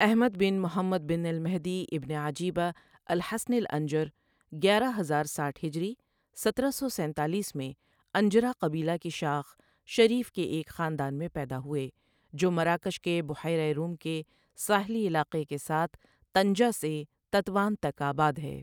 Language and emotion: Urdu, neutral